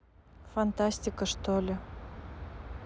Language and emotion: Russian, sad